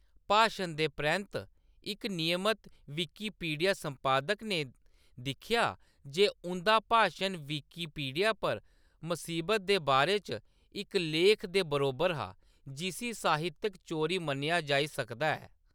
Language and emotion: Dogri, neutral